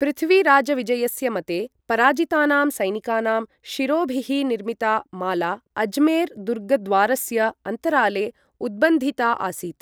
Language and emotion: Sanskrit, neutral